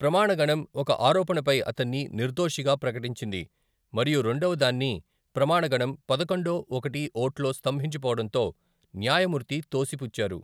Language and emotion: Telugu, neutral